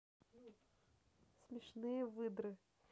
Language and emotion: Russian, neutral